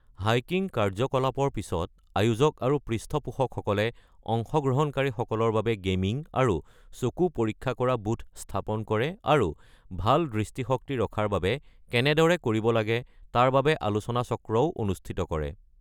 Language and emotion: Assamese, neutral